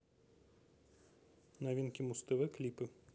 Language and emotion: Russian, neutral